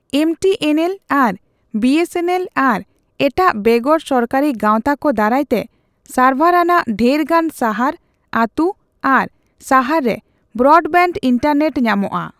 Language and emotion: Santali, neutral